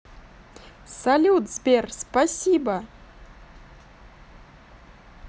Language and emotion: Russian, positive